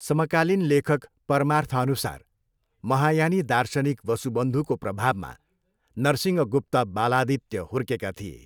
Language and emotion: Nepali, neutral